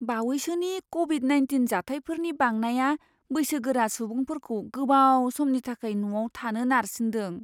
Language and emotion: Bodo, fearful